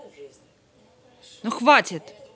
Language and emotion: Russian, angry